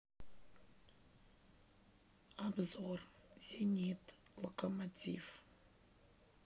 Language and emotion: Russian, neutral